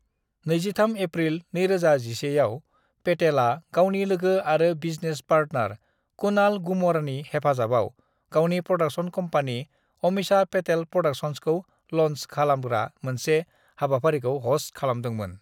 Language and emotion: Bodo, neutral